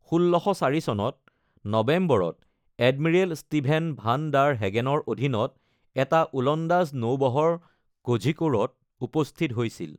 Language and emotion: Assamese, neutral